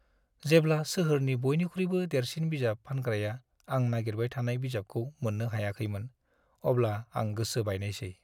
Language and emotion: Bodo, sad